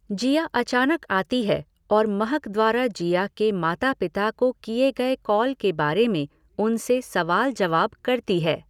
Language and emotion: Hindi, neutral